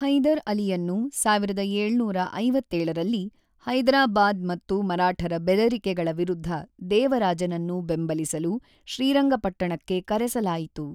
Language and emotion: Kannada, neutral